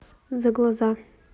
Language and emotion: Russian, neutral